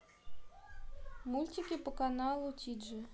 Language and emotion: Russian, neutral